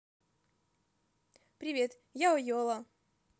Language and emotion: Russian, positive